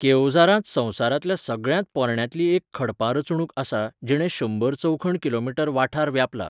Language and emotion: Goan Konkani, neutral